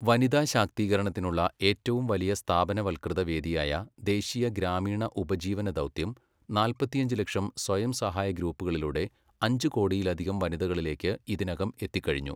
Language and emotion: Malayalam, neutral